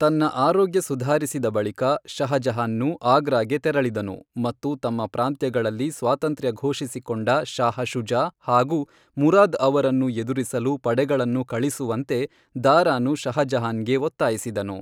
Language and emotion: Kannada, neutral